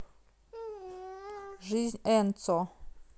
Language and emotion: Russian, neutral